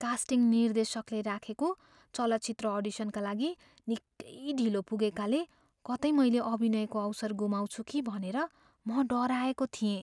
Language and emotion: Nepali, fearful